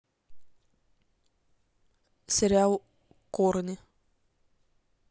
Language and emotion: Russian, neutral